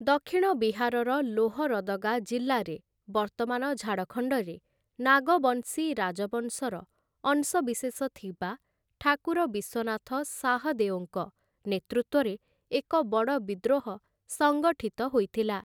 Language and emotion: Odia, neutral